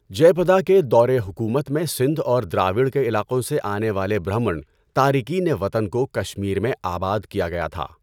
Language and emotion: Urdu, neutral